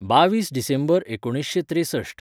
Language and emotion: Goan Konkani, neutral